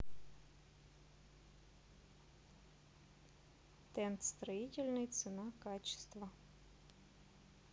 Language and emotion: Russian, neutral